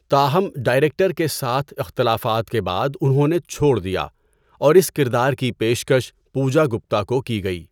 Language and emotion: Urdu, neutral